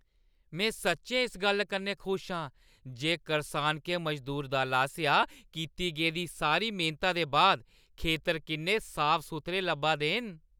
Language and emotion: Dogri, happy